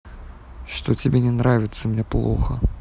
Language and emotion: Russian, sad